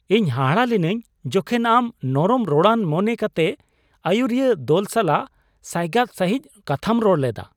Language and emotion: Santali, surprised